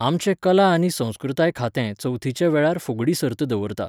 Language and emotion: Goan Konkani, neutral